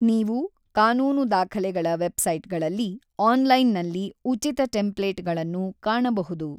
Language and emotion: Kannada, neutral